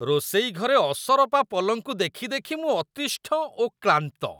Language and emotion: Odia, disgusted